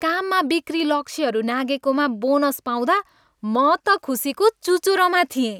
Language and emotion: Nepali, happy